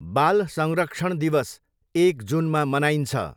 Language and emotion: Nepali, neutral